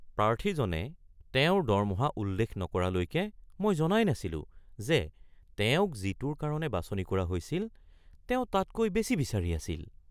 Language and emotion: Assamese, surprised